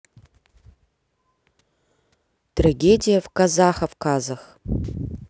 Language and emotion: Russian, sad